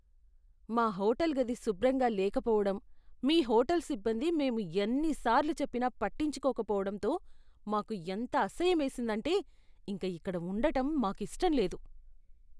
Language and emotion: Telugu, disgusted